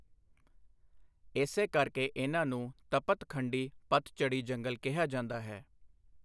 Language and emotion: Punjabi, neutral